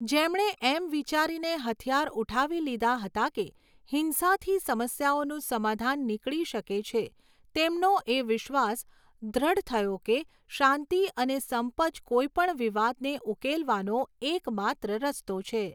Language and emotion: Gujarati, neutral